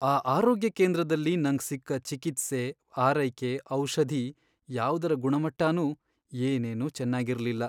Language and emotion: Kannada, sad